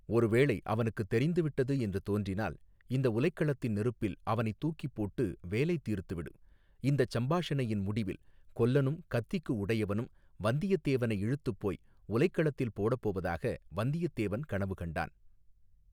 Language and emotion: Tamil, neutral